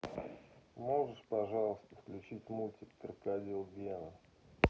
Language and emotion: Russian, neutral